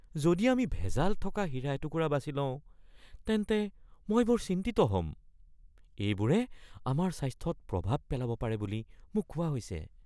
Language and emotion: Assamese, fearful